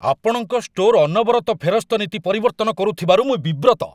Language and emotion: Odia, angry